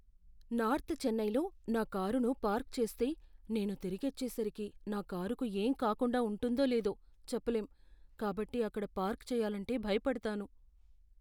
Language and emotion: Telugu, fearful